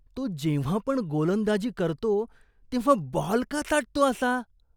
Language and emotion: Marathi, disgusted